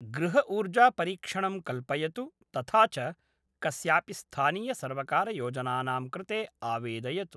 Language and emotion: Sanskrit, neutral